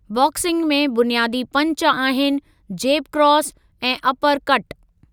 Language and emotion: Sindhi, neutral